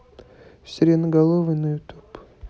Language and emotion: Russian, neutral